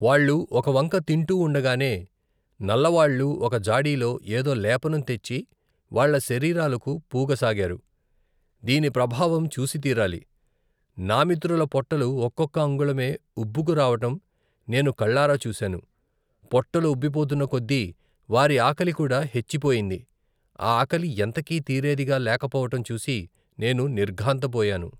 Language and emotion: Telugu, neutral